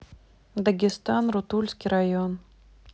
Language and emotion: Russian, neutral